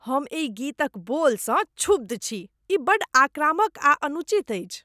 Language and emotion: Maithili, disgusted